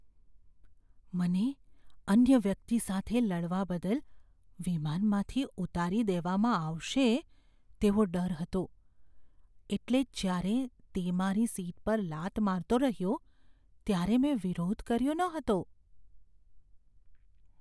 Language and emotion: Gujarati, fearful